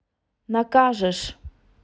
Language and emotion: Russian, neutral